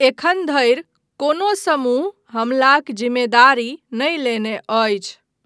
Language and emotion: Maithili, neutral